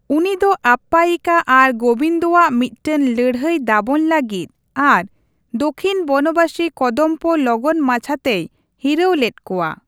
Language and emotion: Santali, neutral